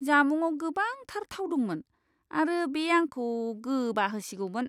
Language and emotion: Bodo, disgusted